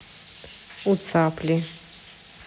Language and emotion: Russian, neutral